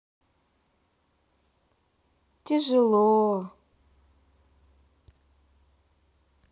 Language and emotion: Russian, sad